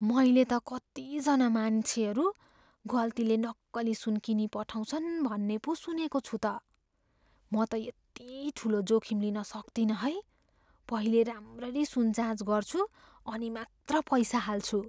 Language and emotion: Nepali, fearful